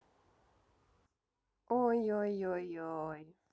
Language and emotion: Russian, neutral